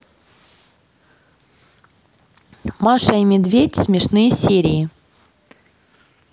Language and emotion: Russian, neutral